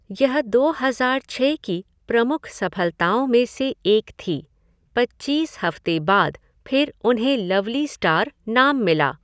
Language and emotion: Hindi, neutral